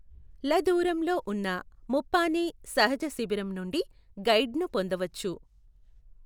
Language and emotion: Telugu, neutral